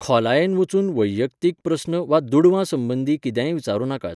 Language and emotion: Goan Konkani, neutral